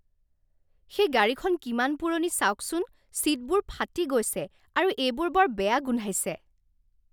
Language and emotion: Assamese, disgusted